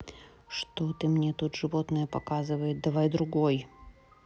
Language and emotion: Russian, neutral